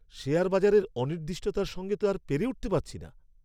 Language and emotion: Bengali, angry